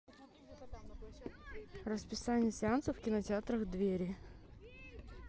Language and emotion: Russian, neutral